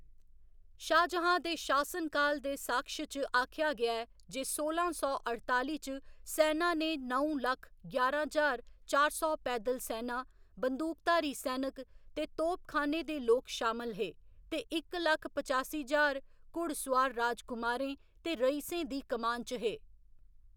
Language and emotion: Dogri, neutral